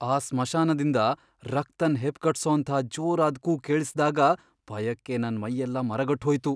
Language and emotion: Kannada, fearful